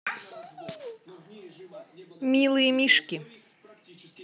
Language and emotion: Russian, positive